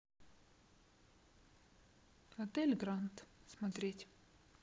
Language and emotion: Russian, neutral